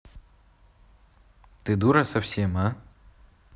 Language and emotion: Russian, angry